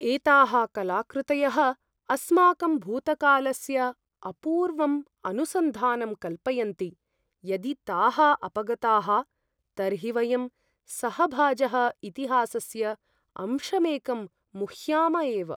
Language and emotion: Sanskrit, fearful